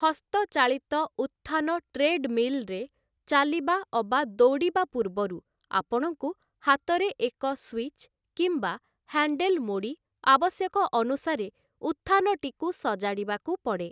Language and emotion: Odia, neutral